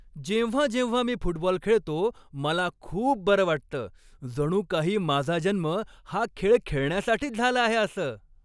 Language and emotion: Marathi, happy